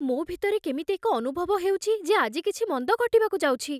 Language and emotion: Odia, fearful